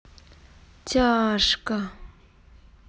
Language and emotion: Russian, sad